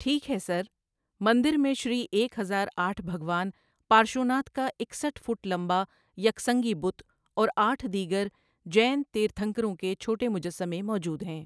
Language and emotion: Urdu, neutral